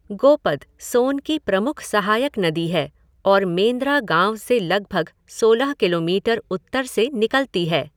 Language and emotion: Hindi, neutral